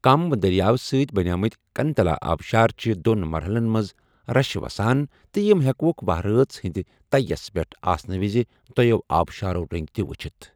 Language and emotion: Kashmiri, neutral